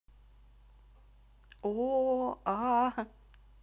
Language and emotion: Russian, neutral